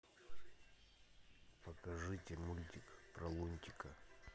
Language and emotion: Russian, neutral